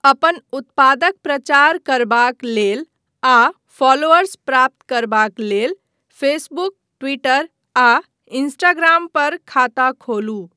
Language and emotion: Maithili, neutral